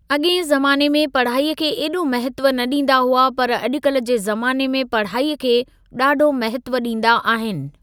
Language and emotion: Sindhi, neutral